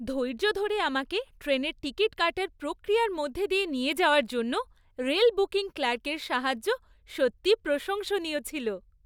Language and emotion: Bengali, happy